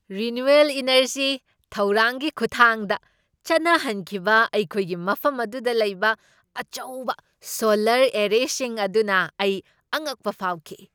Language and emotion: Manipuri, surprised